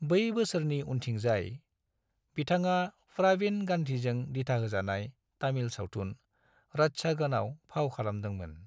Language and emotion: Bodo, neutral